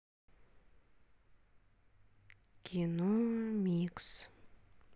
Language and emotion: Russian, neutral